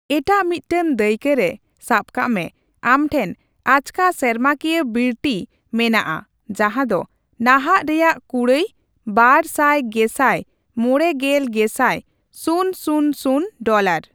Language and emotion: Santali, neutral